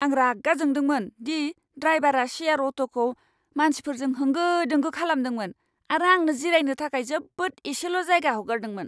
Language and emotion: Bodo, angry